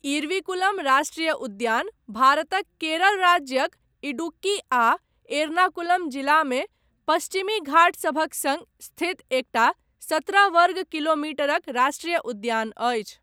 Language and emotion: Maithili, neutral